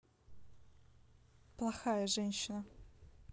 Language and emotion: Russian, neutral